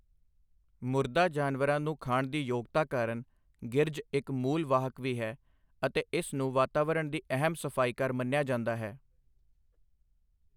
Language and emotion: Punjabi, neutral